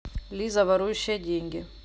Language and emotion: Russian, neutral